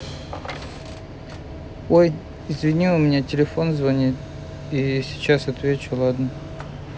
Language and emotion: Russian, neutral